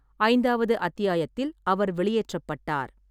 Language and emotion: Tamil, neutral